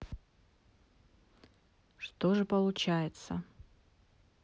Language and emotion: Russian, neutral